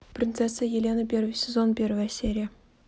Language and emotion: Russian, neutral